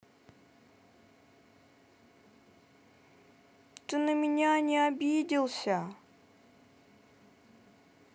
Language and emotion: Russian, sad